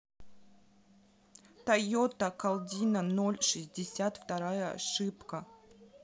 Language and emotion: Russian, neutral